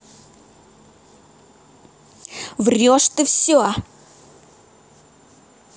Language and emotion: Russian, angry